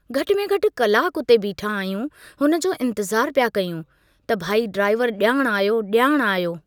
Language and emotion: Sindhi, neutral